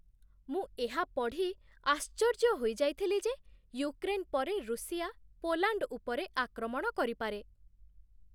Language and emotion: Odia, surprised